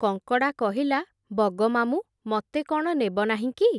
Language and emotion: Odia, neutral